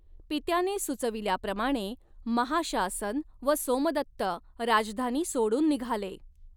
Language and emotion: Marathi, neutral